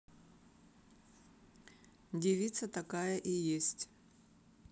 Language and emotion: Russian, neutral